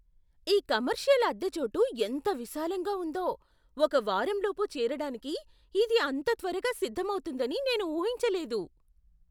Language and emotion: Telugu, surprised